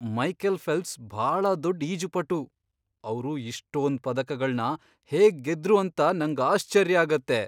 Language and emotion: Kannada, surprised